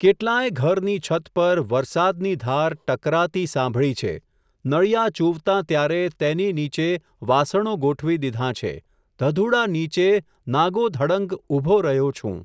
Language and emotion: Gujarati, neutral